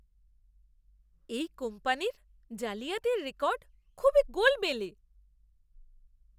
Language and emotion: Bengali, disgusted